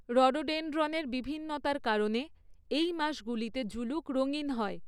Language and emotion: Bengali, neutral